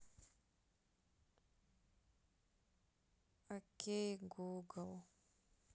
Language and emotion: Russian, sad